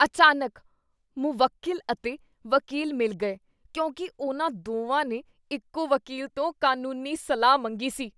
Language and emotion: Punjabi, disgusted